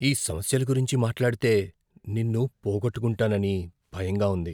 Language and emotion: Telugu, fearful